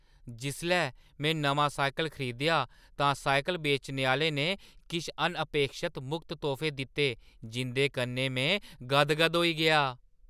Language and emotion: Dogri, surprised